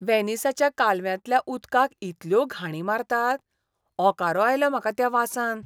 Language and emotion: Goan Konkani, disgusted